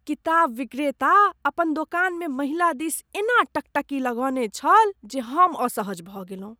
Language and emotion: Maithili, disgusted